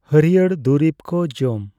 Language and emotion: Santali, neutral